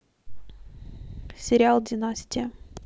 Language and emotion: Russian, neutral